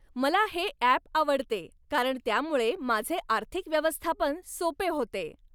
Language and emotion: Marathi, happy